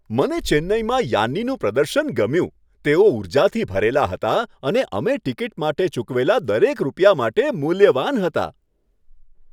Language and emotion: Gujarati, happy